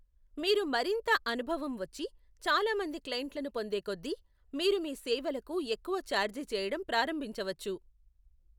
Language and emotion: Telugu, neutral